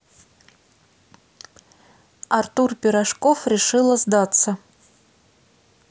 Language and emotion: Russian, neutral